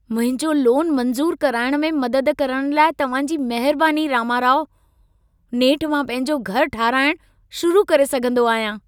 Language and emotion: Sindhi, happy